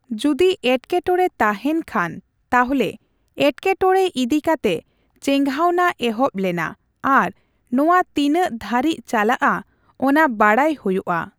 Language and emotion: Santali, neutral